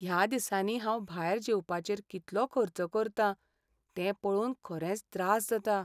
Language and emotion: Goan Konkani, sad